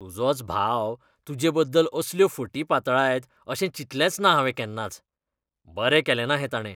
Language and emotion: Goan Konkani, disgusted